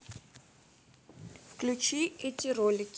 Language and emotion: Russian, neutral